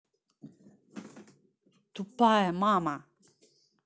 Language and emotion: Russian, angry